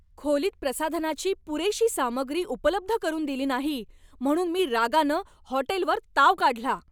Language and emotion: Marathi, angry